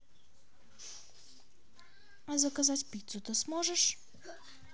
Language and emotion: Russian, neutral